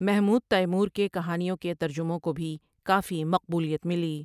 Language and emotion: Urdu, neutral